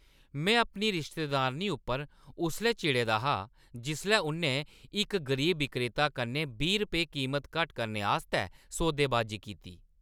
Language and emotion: Dogri, angry